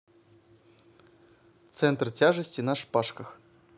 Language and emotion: Russian, neutral